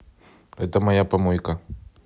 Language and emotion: Russian, neutral